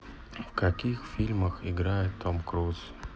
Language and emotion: Russian, sad